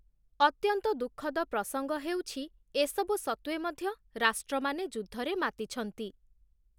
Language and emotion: Odia, neutral